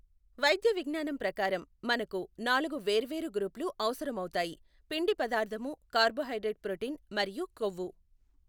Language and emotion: Telugu, neutral